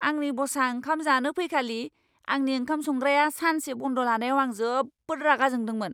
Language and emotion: Bodo, angry